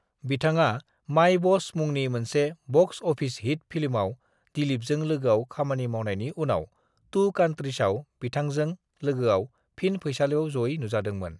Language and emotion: Bodo, neutral